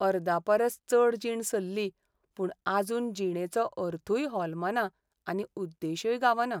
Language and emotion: Goan Konkani, sad